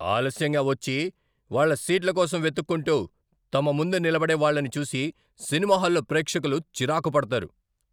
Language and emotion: Telugu, angry